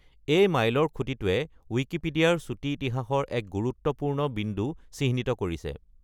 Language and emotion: Assamese, neutral